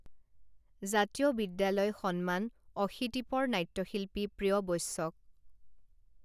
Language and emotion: Assamese, neutral